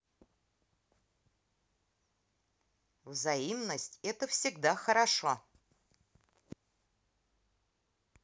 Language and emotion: Russian, positive